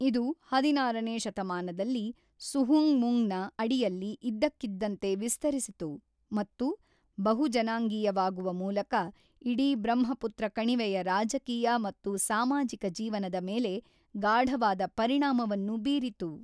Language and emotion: Kannada, neutral